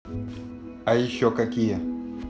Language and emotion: Russian, neutral